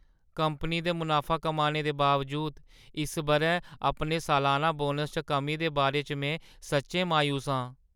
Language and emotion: Dogri, sad